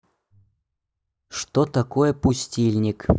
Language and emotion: Russian, neutral